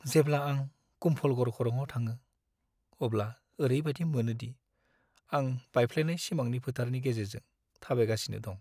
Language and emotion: Bodo, sad